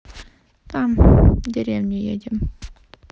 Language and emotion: Russian, sad